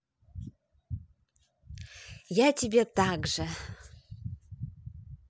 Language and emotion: Russian, positive